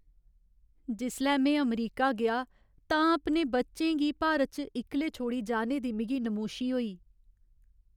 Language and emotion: Dogri, sad